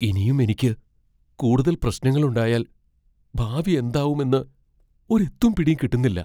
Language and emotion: Malayalam, fearful